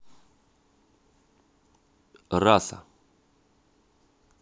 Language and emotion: Russian, neutral